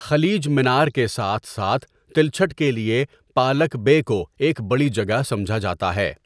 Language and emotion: Urdu, neutral